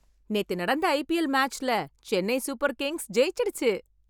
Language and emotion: Tamil, happy